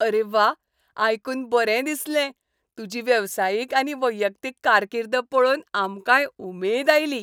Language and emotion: Goan Konkani, happy